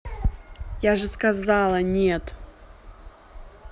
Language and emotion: Russian, angry